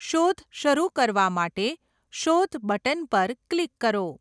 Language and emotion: Gujarati, neutral